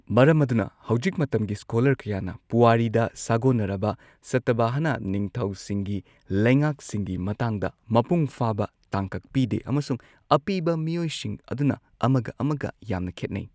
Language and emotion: Manipuri, neutral